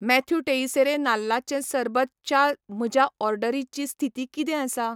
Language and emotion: Goan Konkani, neutral